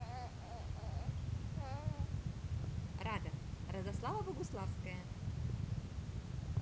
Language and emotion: Russian, positive